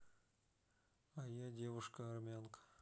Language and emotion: Russian, neutral